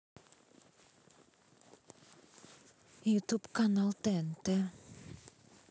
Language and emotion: Russian, neutral